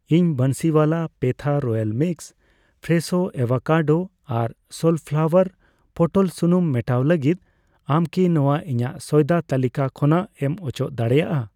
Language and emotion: Santali, neutral